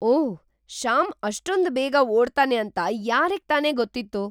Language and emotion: Kannada, surprised